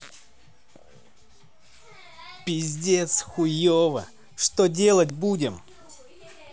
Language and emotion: Russian, angry